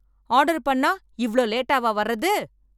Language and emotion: Tamil, angry